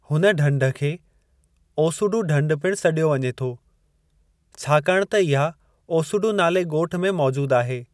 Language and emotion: Sindhi, neutral